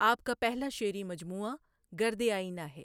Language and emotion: Urdu, neutral